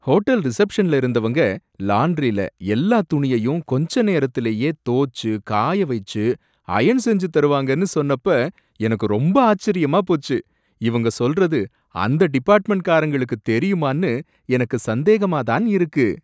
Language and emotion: Tamil, surprised